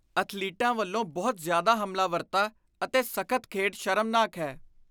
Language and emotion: Punjabi, disgusted